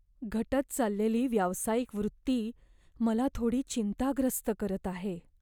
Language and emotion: Marathi, fearful